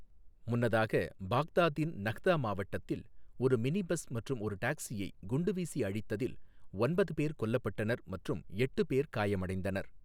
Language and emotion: Tamil, neutral